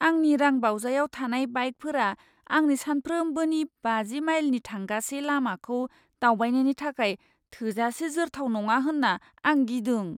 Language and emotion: Bodo, fearful